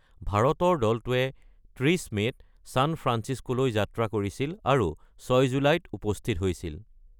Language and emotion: Assamese, neutral